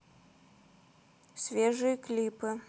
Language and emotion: Russian, neutral